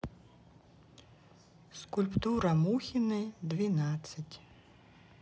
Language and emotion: Russian, neutral